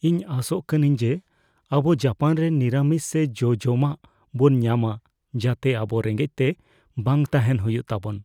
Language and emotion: Santali, fearful